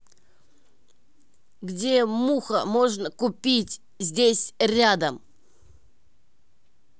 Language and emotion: Russian, angry